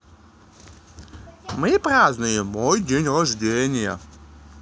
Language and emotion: Russian, positive